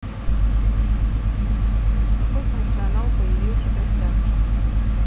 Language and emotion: Russian, neutral